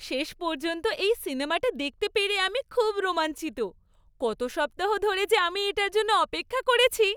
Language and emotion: Bengali, happy